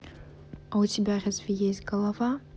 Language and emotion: Russian, neutral